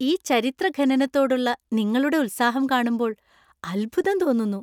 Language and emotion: Malayalam, happy